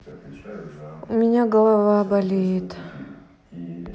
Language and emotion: Russian, sad